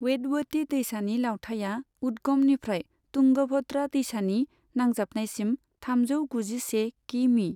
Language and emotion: Bodo, neutral